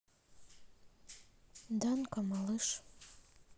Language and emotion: Russian, sad